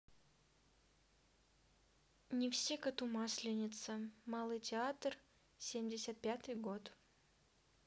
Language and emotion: Russian, neutral